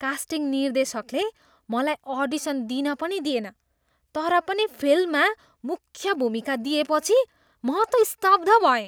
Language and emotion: Nepali, surprised